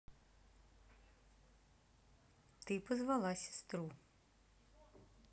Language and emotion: Russian, neutral